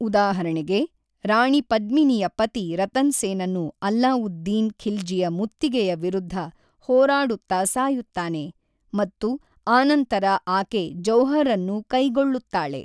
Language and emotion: Kannada, neutral